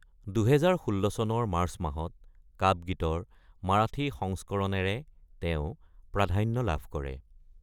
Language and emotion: Assamese, neutral